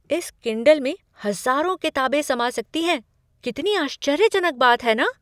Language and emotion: Hindi, surprised